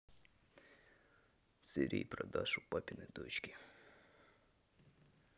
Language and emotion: Russian, sad